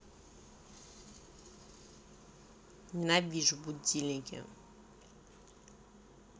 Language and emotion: Russian, angry